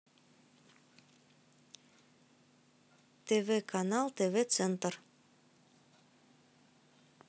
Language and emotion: Russian, neutral